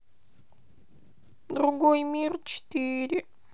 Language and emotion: Russian, sad